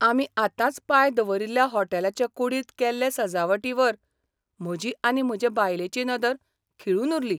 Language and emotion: Goan Konkani, surprised